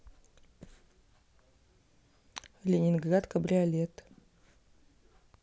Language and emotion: Russian, neutral